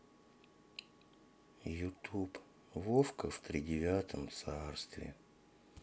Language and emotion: Russian, sad